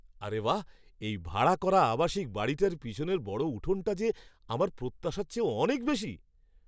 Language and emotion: Bengali, surprised